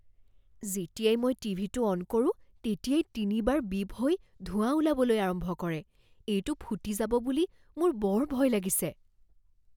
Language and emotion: Assamese, fearful